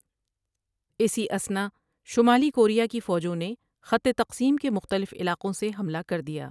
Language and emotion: Urdu, neutral